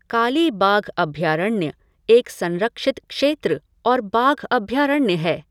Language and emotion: Hindi, neutral